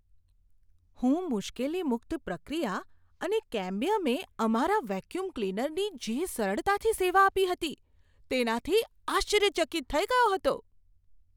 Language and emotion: Gujarati, surprised